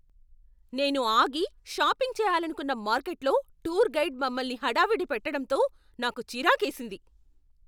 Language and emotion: Telugu, angry